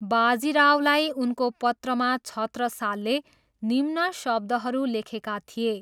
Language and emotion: Nepali, neutral